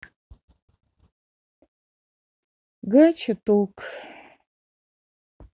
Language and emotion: Russian, sad